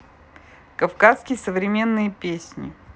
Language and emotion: Russian, neutral